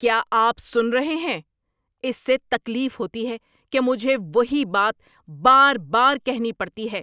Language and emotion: Urdu, angry